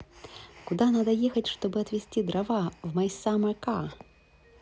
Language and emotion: Russian, neutral